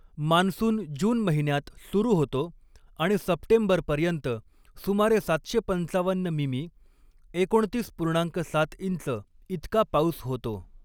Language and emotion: Marathi, neutral